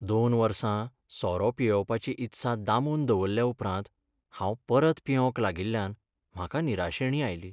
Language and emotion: Goan Konkani, sad